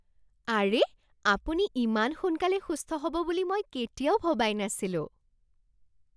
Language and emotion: Assamese, surprised